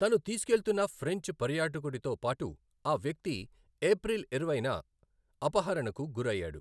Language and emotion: Telugu, neutral